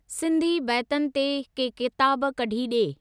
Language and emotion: Sindhi, neutral